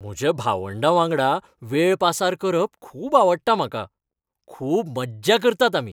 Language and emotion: Goan Konkani, happy